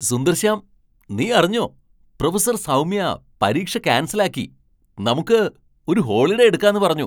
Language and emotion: Malayalam, surprised